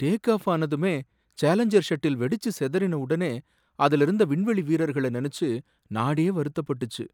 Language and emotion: Tamil, sad